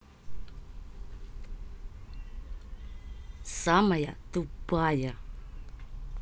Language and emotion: Russian, angry